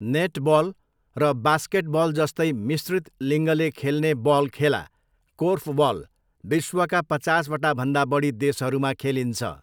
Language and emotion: Nepali, neutral